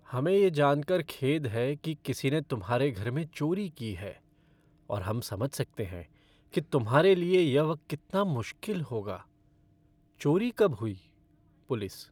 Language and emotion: Hindi, sad